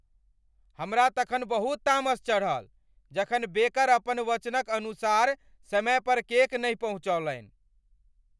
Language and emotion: Maithili, angry